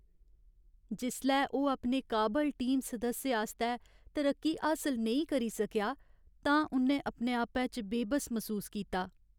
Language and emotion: Dogri, sad